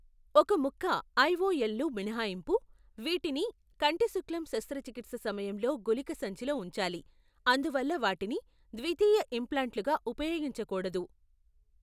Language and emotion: Telugu, neutral